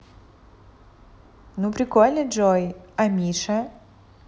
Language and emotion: Russian, positive